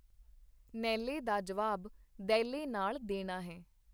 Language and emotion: Punjabi, neutral